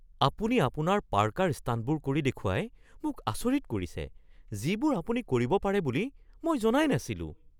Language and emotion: Assamese, surprised